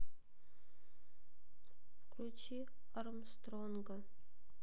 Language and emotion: Russian, sad